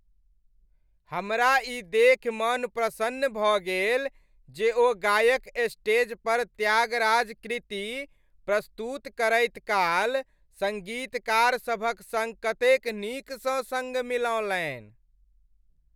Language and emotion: Maithili, happy